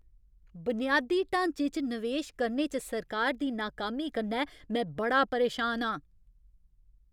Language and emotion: Dogri, angry